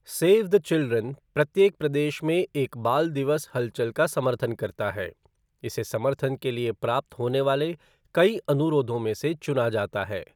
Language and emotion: Hindi, neutral